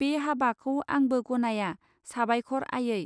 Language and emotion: Bodo, neutral